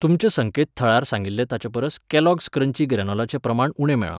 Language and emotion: Goan Konkani, neutral